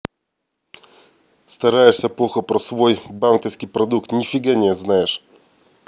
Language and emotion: Russian, angry